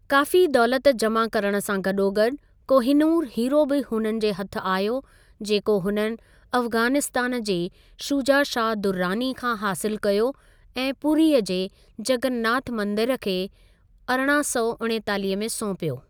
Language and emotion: Sindhi, neutral